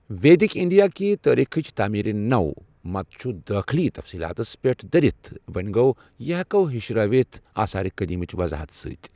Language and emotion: Kashmiri, neutral